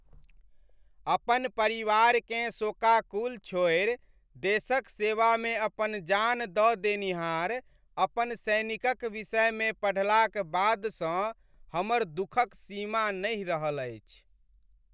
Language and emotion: Maithili, sad